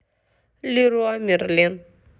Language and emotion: Russian, neutral